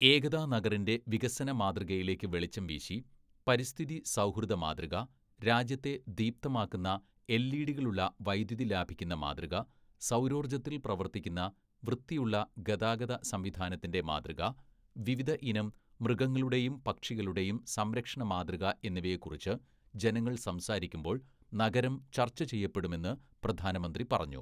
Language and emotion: Malayalam, neutral